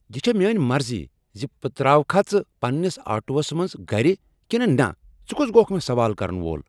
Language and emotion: Kashmiri, angry